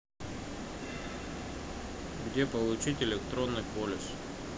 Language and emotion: Russian, neutral